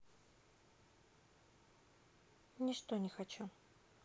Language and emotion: Russian, sad